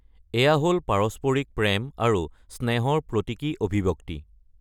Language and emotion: Assamese, neutral